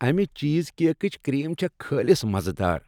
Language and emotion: Kashmiri, happy